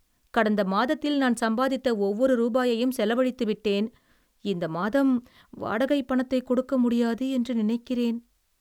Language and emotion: Tamil, sad